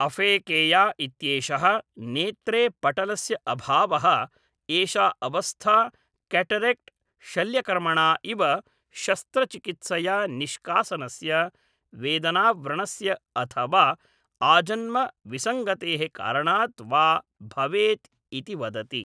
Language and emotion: Sanskrit, neutral